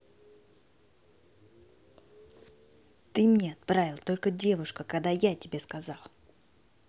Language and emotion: Russian, angry